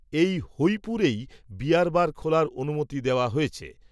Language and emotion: Bengali, neutral